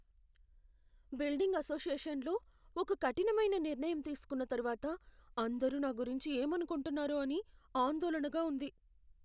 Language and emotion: Telugu, fearful